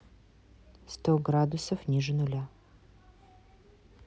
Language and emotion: Russian, neutral